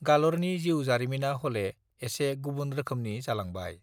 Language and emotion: Bodo, neutral